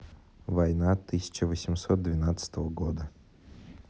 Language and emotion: Russian, neutral